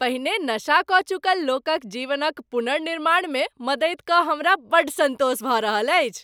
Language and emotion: Maithili, happy